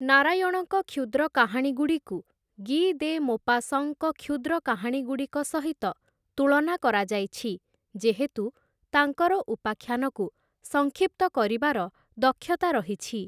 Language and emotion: Odia, neutral